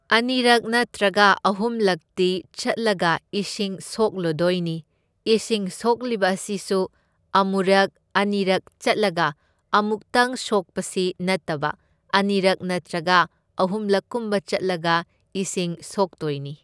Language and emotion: Manipuri, neutral